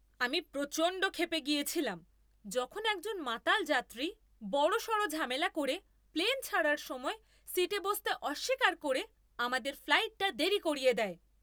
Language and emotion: Bengali, angry